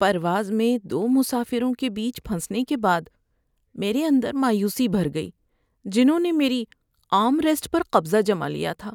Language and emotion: Urdu, sad